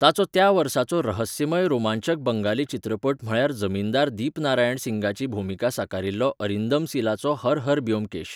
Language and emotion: Goan Konkani, neutral